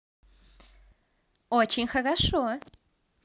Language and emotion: Russian, positive